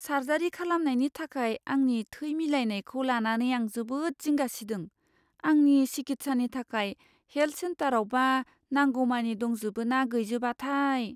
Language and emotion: Bodo, fearful